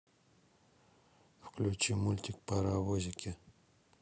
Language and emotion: Russian, neutral